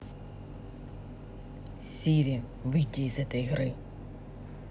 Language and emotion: Russian, angry